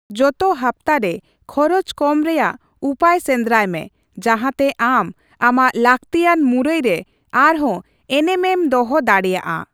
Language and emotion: Santali, neutral